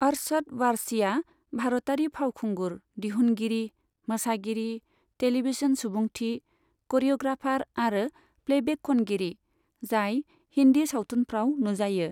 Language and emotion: Bodo, neutral